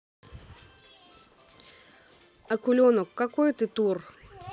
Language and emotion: Russian, neutral